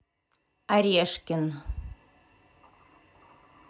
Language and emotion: Russian, neutral